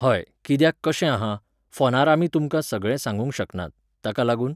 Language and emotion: Goan Konkani, neutral